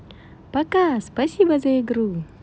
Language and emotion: Russian, positive